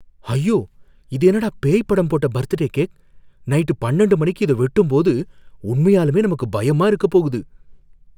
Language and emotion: Tamil, fearful